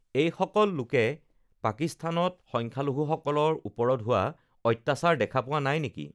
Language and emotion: Assamese, neutral